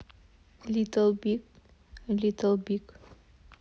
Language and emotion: Russian, neutral